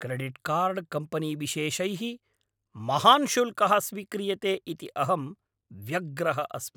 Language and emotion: Sanskrit, angry